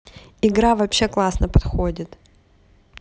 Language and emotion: Russian, positive